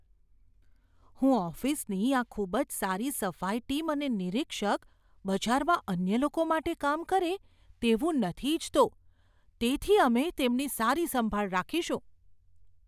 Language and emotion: Gujarati, fearful